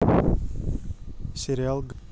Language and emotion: Russian, neutral